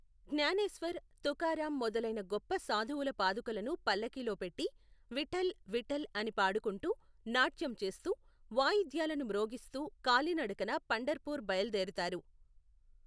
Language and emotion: Telugu, neutral